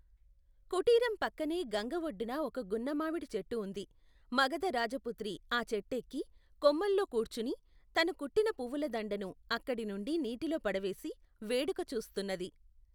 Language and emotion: Telugu, neutral